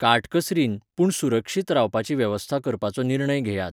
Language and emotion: Goan Konkani, neutral